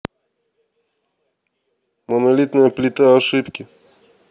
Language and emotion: Russian, neutral